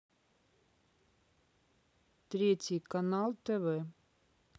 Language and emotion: Russian, neutral